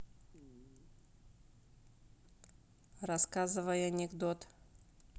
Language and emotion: Russian, neutral